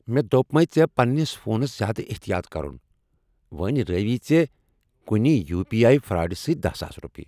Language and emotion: Kashmiri, angry